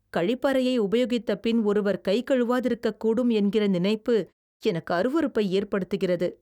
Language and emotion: Tamil, disgusted